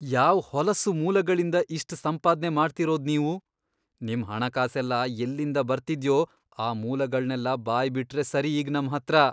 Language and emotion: Kannada, disgusted